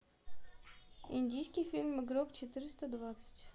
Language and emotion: Russian, neutral